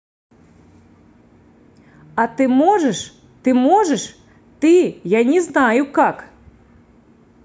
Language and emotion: Russian, angry